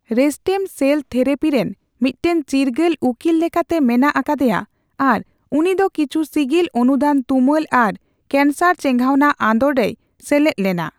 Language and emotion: Santali, neutral